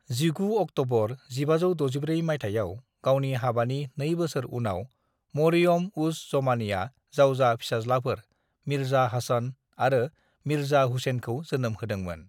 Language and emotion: Bodo, neutral